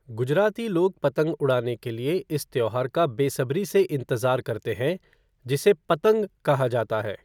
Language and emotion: Hindi, neutral